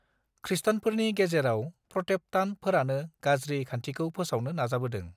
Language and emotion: Bodo, neutral